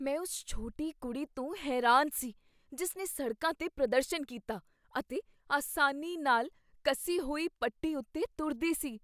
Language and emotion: Punjabi, surprised